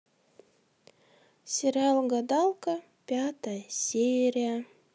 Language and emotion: Russian, neutral